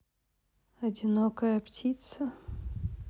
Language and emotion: Russian, sad